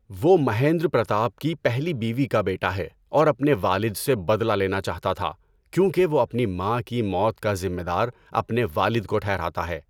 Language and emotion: Urdu, neutral